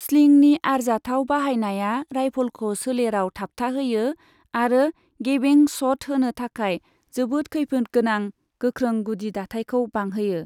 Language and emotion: Bodo, neutral